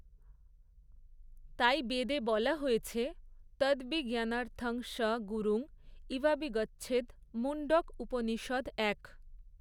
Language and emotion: Bengali, neutral